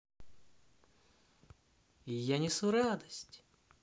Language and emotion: Russian, positive